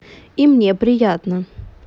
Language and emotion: Russian, positive